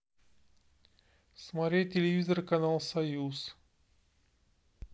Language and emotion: Russian, neutral